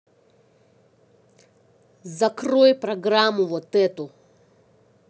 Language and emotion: Russian, angry